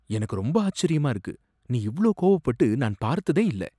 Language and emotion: Tamil, surprised